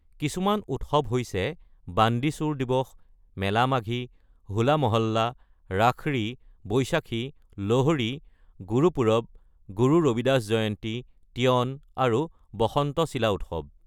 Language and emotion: Assamese, neutral